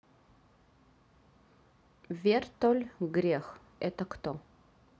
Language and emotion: Russian, neutral